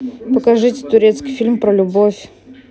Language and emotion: Russian, neutral